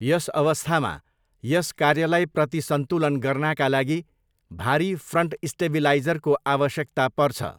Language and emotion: Nepali, neutral